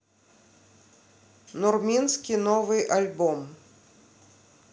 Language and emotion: Russian, neutral